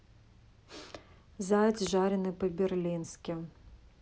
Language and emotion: Russian, neutral